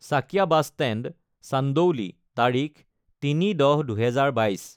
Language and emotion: Assamese, neutral